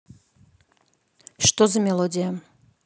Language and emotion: Russian, neutral